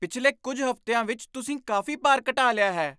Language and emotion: Punjabi, surprised